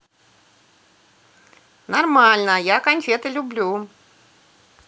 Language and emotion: Russian, positive